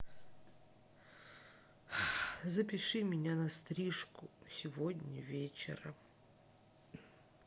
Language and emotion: Russian, sad